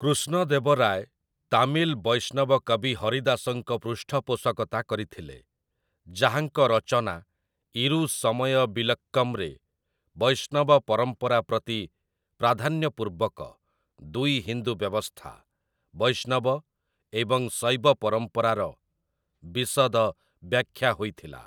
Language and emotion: Odia, neutral